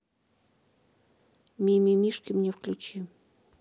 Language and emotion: Russian, neutral